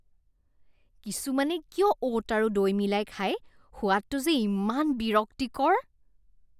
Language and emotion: Assamese, disgusted